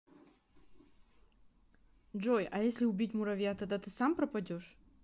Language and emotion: Russian, neutral